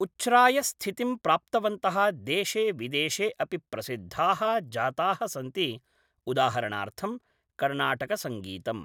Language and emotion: Sanskrit, neutral